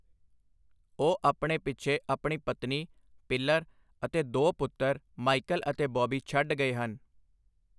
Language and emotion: Punjabi, neutral